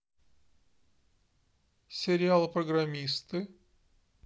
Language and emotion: Russian, neutral